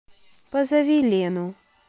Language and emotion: Russian, sad